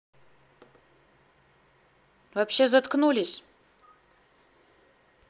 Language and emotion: Russian, angry